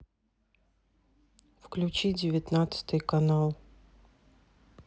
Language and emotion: Russian, sad